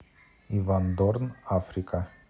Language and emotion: Russian, neutral